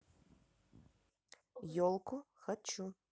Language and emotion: Russian, neutral